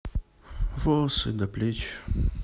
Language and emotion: Russian, sad